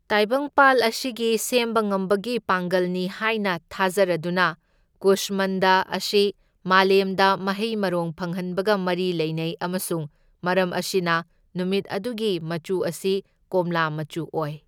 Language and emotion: Manipuri, neutral